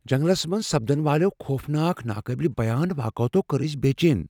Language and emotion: Kashmiri, fearful